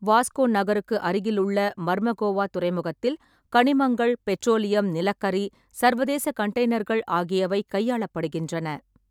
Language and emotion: Tamil, neutral